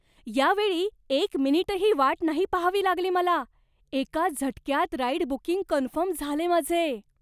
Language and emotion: Marathi, surprised